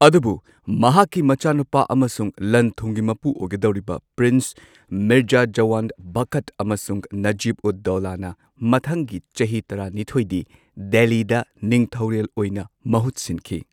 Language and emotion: Manipuri, neutral